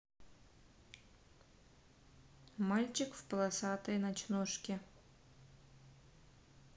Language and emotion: Russian, neutral